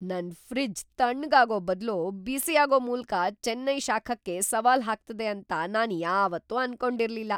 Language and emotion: Kannada, surprised